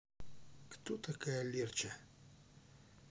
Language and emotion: Russian, neutral